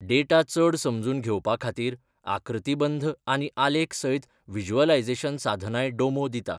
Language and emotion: Goan Konkani, neutral